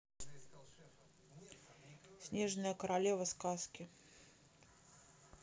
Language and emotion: Russian, neutral